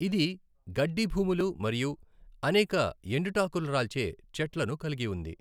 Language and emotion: Telugu, neutral